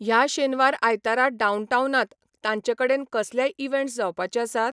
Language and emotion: Goan Konkani, neutral